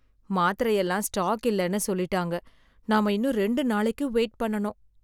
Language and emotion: Tamil, sad